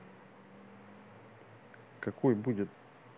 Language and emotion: Russian, neutral